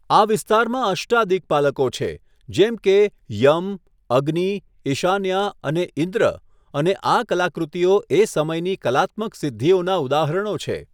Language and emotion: Gujarati, neutral